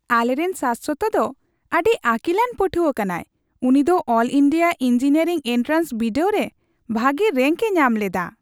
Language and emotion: Santali, happy